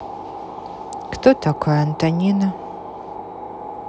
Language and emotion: Russian, neutral